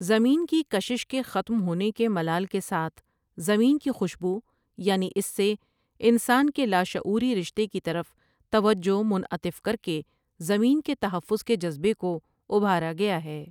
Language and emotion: Urdu, neutral